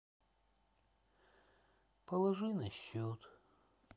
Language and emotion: Russian, sad